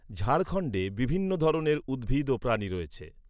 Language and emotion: Bengali, neutral